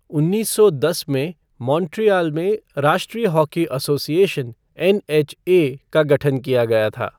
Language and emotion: Hindi, neutral